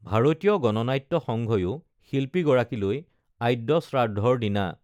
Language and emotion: Assamese, neutral